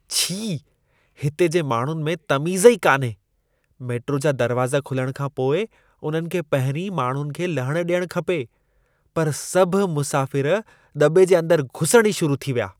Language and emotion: Sindhi, disgusted